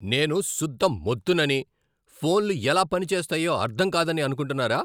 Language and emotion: Telugu, angry